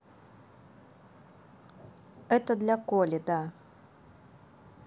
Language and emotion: Russian, neutral